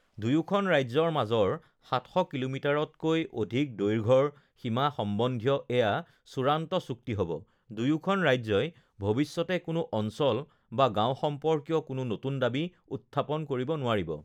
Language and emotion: Assamese, neutral